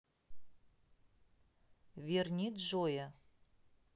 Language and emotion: Russian, neutral